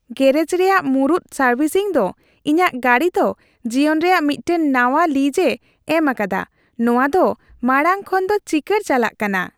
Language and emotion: Santali, happy